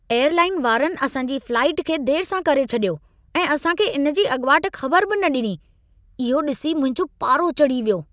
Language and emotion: Sindhi, angry